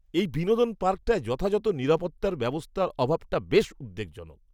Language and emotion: Bengali, disgusted